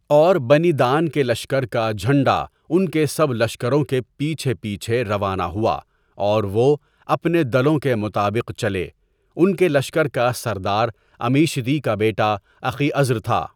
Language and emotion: Urdu, neutral